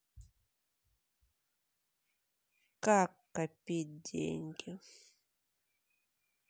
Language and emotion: Russian, sad